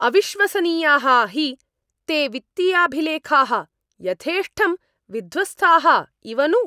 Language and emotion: Sanskrit, angry